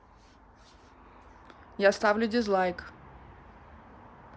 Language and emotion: Russian, neutral